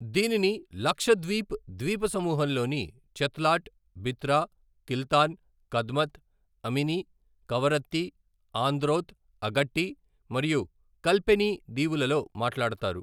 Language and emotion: Telugu, neutral